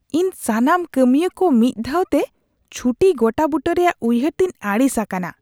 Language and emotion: Santali, disgusted